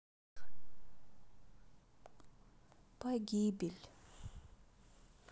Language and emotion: Russian, sad